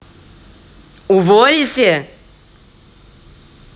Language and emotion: Russian, angry